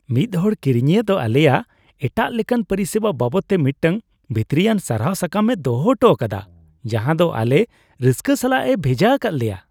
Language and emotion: Santali, happy